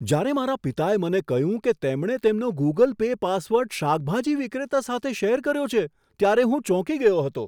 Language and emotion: Gujarati, surprised